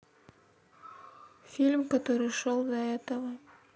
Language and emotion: Russian, sad